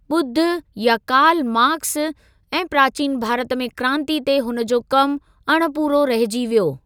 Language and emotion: Sindhi, neutral